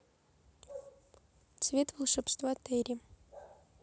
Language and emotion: Russian, neutral